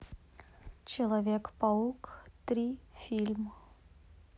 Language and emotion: Russian, neutral